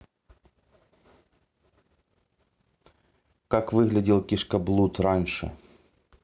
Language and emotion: Russian, neutral